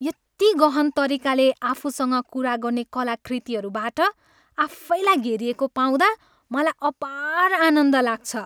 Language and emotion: Nepali, happy